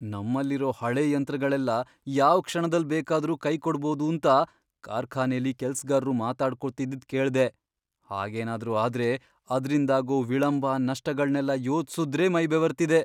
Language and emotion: Kannada, fearful